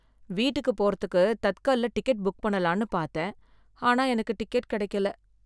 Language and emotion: Tamil, sad